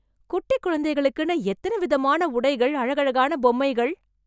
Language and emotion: Tamil, surprised